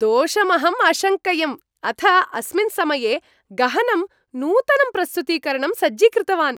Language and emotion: Sanskrit, happy